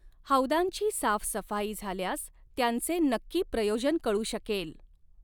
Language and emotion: Marathi, neutral